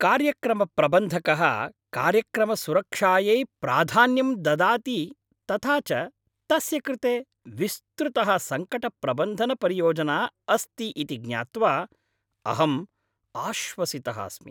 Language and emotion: Sanskrit, happy